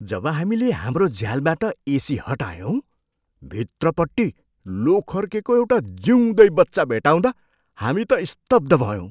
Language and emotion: Nepali, surprised